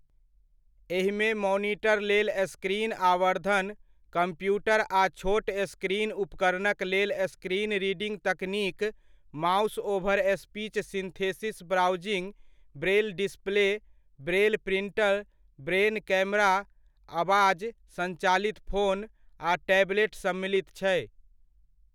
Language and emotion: Maithili, neutral